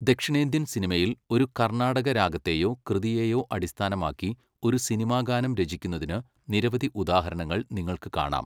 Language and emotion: Malayalam, neutral